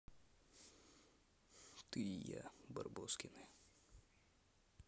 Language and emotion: Russian, neutral